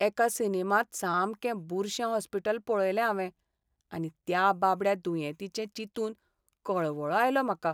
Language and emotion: Goan Konkani, sad